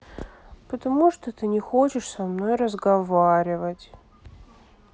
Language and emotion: Russian, sad